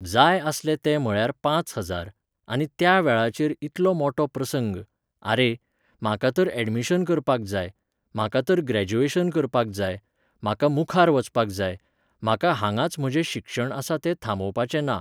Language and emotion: Goan Konkani, neutral